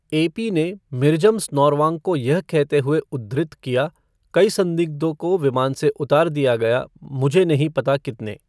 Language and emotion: Hindi, neutral